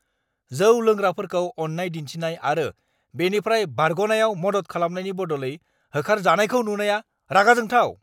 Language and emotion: Bodo, angry